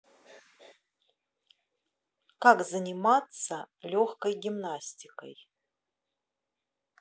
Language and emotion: Russian, neutral